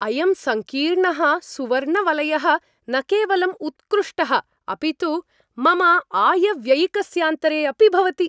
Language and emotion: Sanskrit, happy